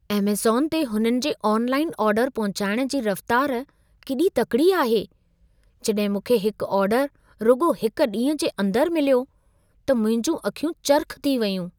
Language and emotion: Sindhi, surprised